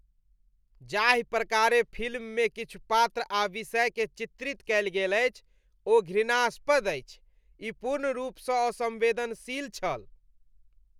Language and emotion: Maithili, disgusted